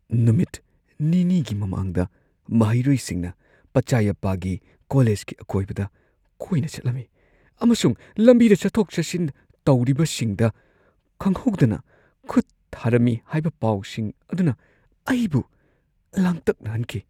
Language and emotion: Manipuri, fearful